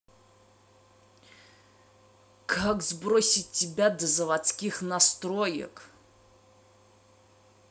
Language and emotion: Russian, angry